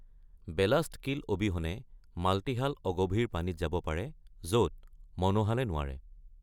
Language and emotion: Assamese, neutral